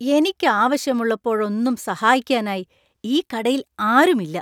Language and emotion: Malayalam, disgusted